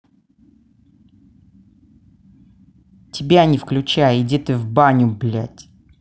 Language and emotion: Russian, angry